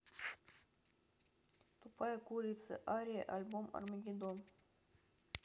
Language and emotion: Russian, neutral